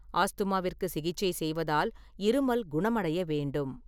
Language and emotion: Tamil, neutral